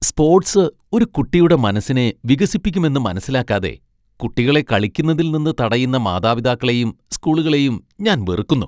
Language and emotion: Malayalam, disgusted